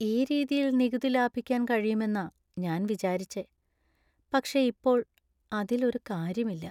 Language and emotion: Malayalam, sad